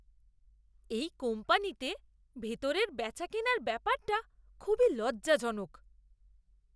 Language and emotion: Bengali, disgusted